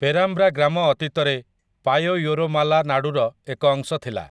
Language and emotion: Odia, neutral